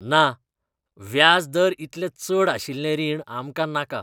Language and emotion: Goan Konkani, disgusted